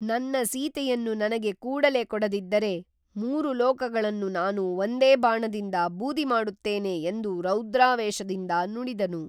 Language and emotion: Kannada, neutral